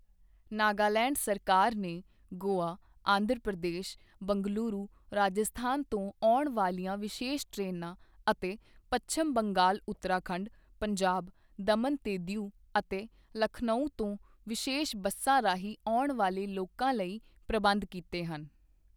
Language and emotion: Punjabi, neutral